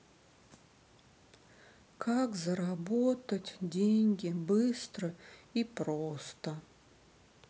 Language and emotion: Russian, sad